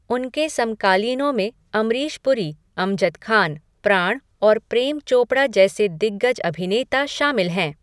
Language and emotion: Hindi, neutral